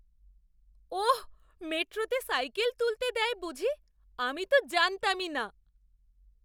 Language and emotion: Bengali, surprised